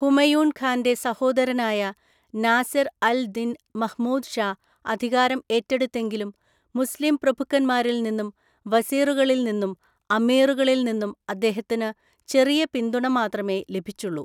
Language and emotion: Malayalam, neutral